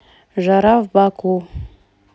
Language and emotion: Russian, neutral